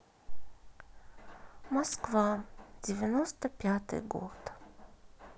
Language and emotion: Russian, sad